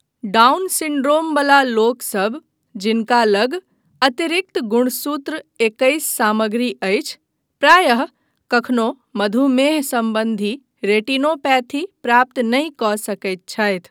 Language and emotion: Maithili, neutral